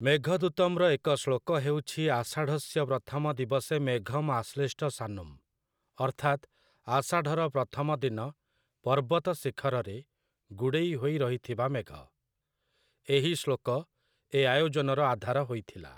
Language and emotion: Odia, neutral